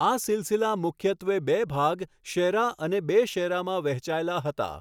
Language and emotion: Gujarati, neutral